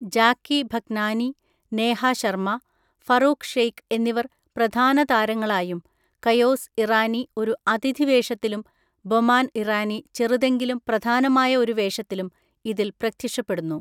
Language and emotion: Malayalam, neutral